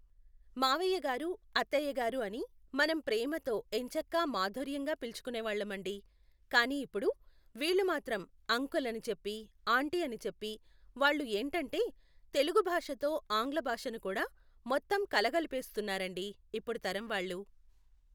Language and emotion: Telugu, neutral